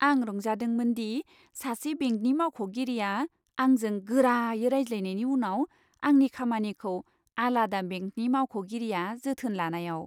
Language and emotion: Bodo, happy